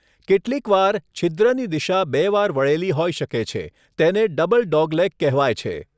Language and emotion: Gujarati, neutral